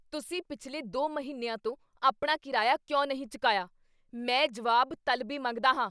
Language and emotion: Punjabi, angry